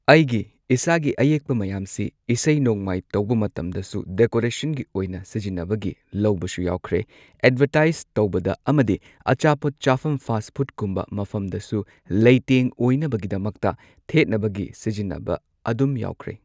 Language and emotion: Manipuri, neutral